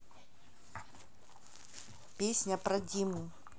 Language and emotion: Russian, neutral